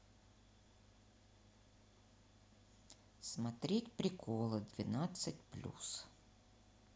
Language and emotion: Russian, neutral